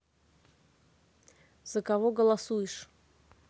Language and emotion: Russian, neutral